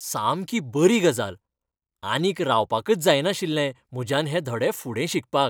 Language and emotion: Goan Konkani, happy